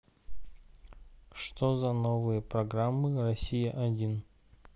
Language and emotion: Russian, neutral